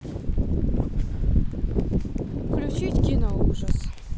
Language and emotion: Russian, neutral